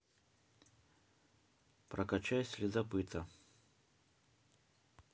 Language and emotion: Russian, neutral